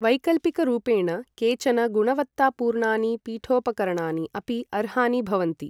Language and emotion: Sanskrit, neutral